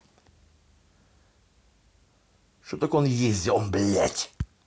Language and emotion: Russian, angry